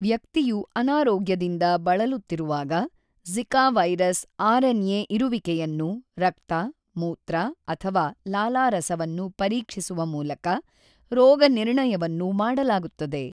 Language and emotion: Kannada, neutral